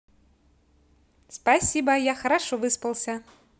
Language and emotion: Russian, positive